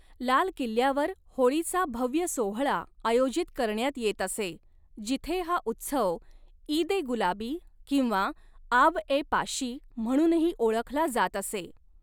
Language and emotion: Marathi, neutral